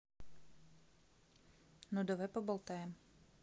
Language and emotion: Russian, neutral